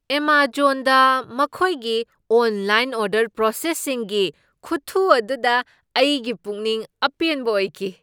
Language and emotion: Manipuri, surprised